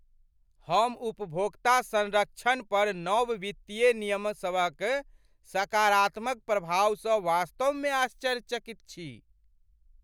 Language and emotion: Maithili, surprised